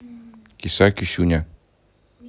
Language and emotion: Russian, neutral